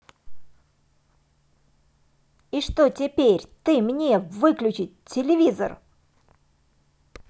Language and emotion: Russian, angry